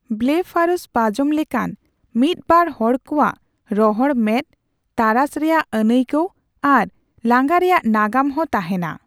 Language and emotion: Santali, neutral